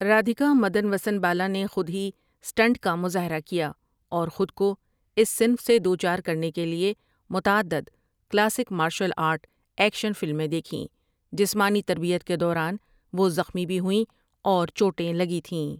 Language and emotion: Urdu, neutral